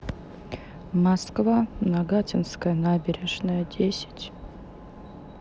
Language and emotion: Russian, sad